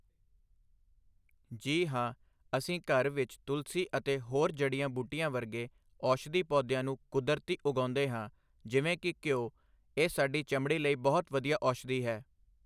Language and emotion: Punjabi, neutral